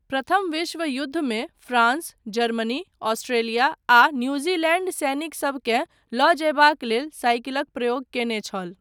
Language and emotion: Maithili, neutral